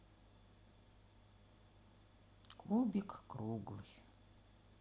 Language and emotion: Russian, sad